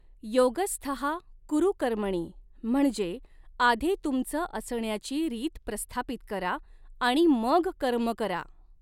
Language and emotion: Marathi, neutral